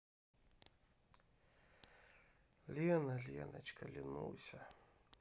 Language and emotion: Russian, sad